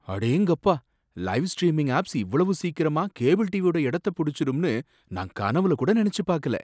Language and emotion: Tamil, surprised